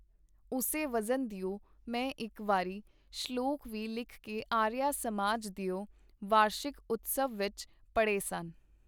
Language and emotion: Punjabi, neutral